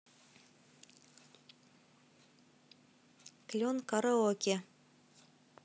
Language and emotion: Russian, neutral